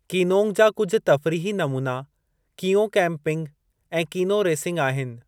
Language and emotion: Sindhi, neutral